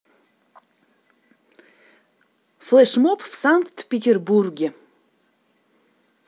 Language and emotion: Russian, neutral